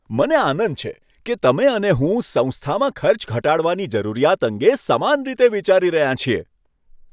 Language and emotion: Gujarati, happy